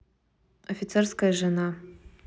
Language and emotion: Russian, neutral